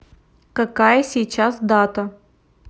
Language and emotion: Russian, neutral